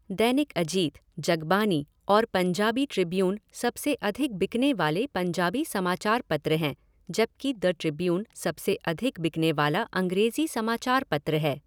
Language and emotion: Hindi, neutral